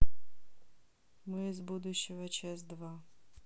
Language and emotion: Russian, neutral